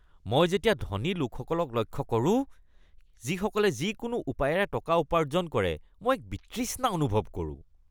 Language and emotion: Assamese, disgusted